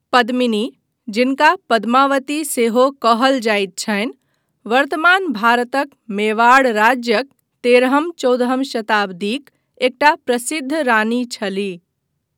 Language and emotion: Maithili, neutral